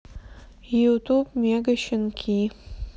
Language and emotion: Russian, sad